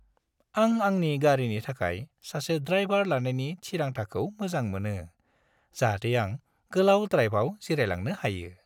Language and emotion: Bodo, happy